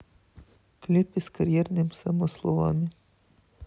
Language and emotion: Russian, neutral